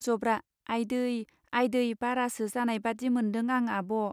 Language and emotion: Bodo, neutral